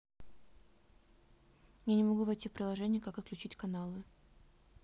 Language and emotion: Russian, neutral